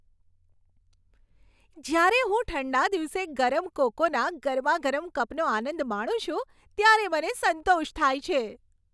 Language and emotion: Gujarati, happy